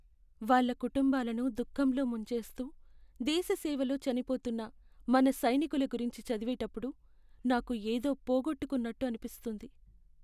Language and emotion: Telugu, sad